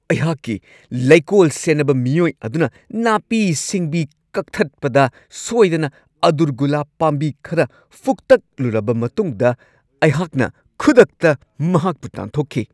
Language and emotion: Manipuri, angry